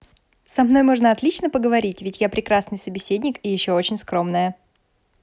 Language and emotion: Russian, positive